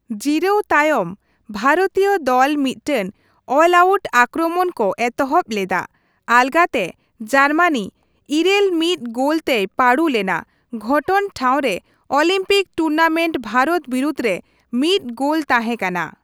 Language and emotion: Santali, neutral